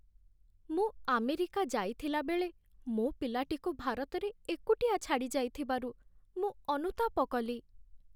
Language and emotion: Odia, sad